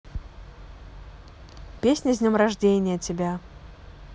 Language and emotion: Russian, neutral